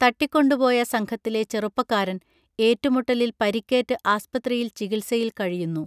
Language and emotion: Malayalam, neutral